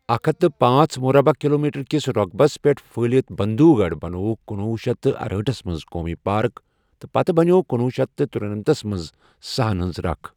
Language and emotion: Kashmiri, neutral